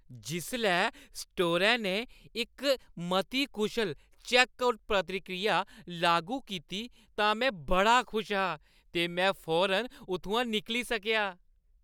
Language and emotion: Dogri, happy